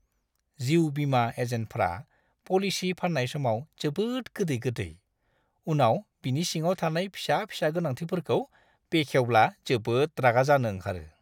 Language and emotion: Bodo, disgusted